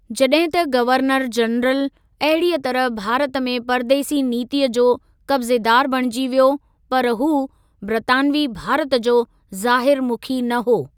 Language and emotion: Sindhi, neutral